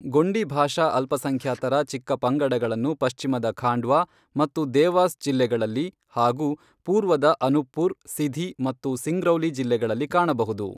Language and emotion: Kannada, neutral